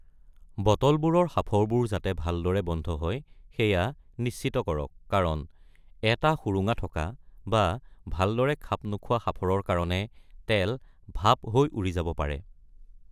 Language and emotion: Assamese, neutral